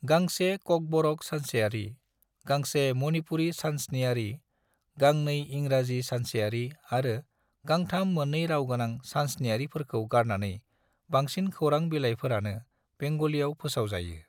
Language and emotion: Bodo, neutral